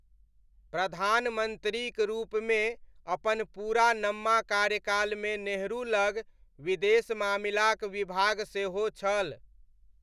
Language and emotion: Maithili, neutral